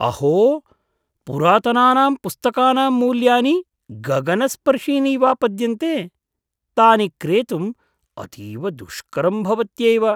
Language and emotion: Sanskrit, surprised